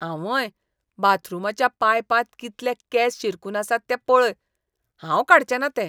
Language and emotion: Goan Konkani, disgusted